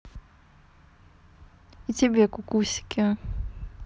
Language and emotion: Russian, neutral